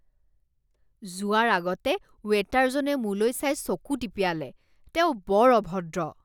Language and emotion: Assamese, disgusted